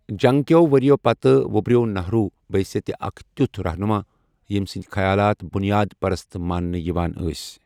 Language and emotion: Kashmiri, neutral